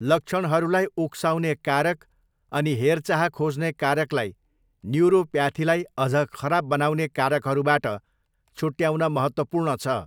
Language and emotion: Nepali, neutral